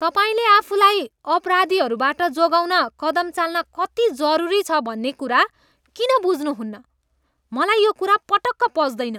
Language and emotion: Nepali, disgusted